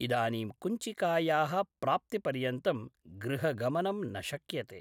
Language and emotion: Sanskrit, neutral